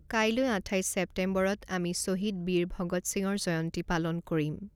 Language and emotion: Assamese, neutral